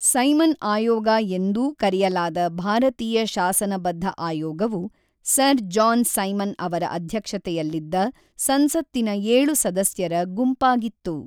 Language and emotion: Kannada, neutral